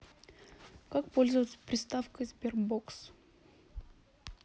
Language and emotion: Russian, neutral